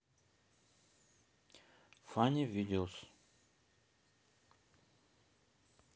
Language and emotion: Russian, neutral